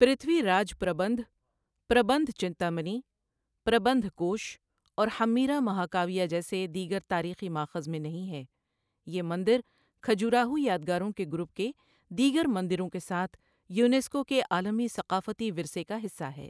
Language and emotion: Urdu, neutral